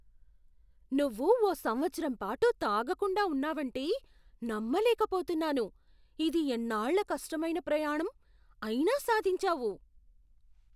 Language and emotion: Telugu, surprised